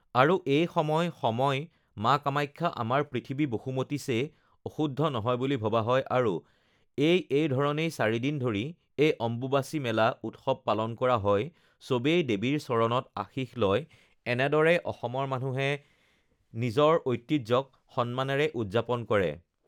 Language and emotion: Assamese, neutral